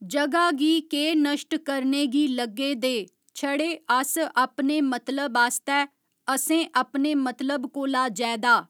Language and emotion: Dogri, neutral